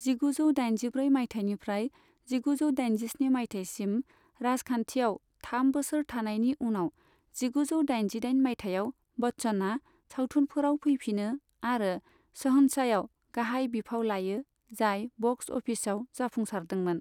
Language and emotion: Bodo, neutral